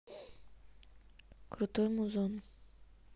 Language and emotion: Russian, neutral